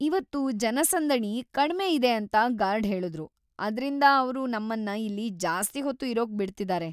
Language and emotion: Kannada, happy